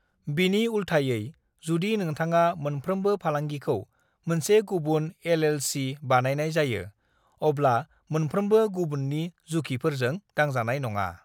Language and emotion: Bodo, neutral